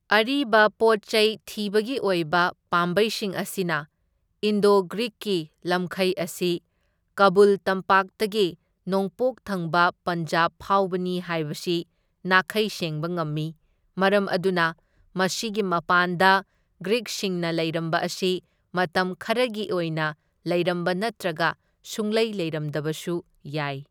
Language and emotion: Manipuri, neutral